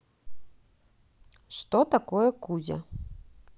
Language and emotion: Russian, neutral